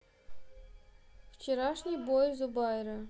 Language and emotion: Russian, neutral